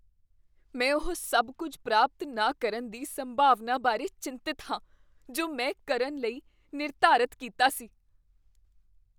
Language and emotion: Punjabi, fearful